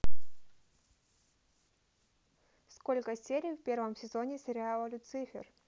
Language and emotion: Russian, neutral